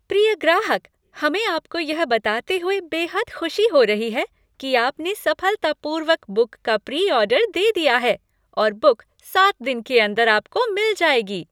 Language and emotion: Hindi, happy